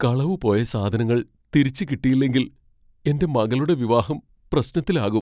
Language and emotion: Malayalam, fearful